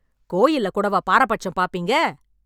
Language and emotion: Tamil, angry